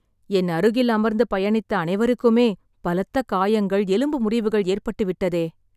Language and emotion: Tamil, sad